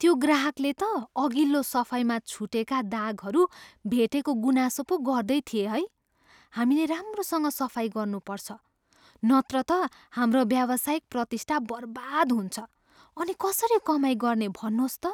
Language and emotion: Nepali, fearful